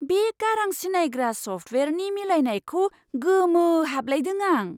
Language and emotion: Bodo, surprised